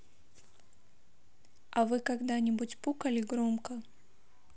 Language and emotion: Russian, neutral